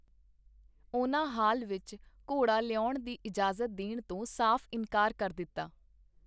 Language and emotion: Punjabi, neutral